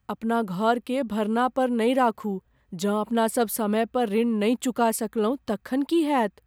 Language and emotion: Maithili, fearful